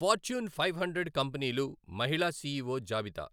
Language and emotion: Telugu, neutral